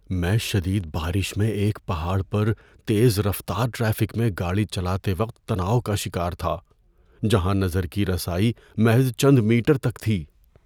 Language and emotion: Urdu, fearful